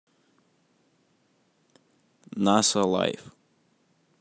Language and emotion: Russian, neutral